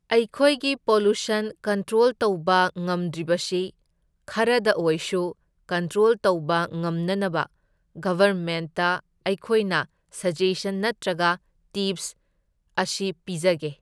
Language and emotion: Manipuri, neutral